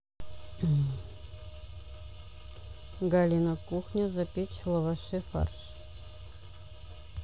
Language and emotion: Russian, neutral